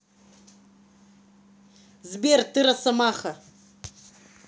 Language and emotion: Russian, angry